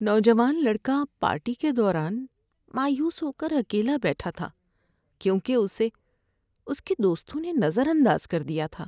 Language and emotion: Urdu, sad